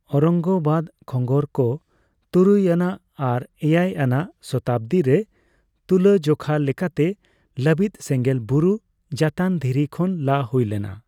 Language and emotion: Santali, neutral